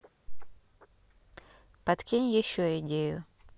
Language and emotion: Russian, neutral